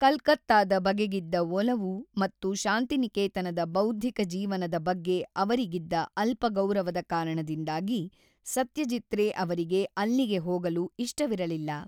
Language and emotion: Kannada, neutral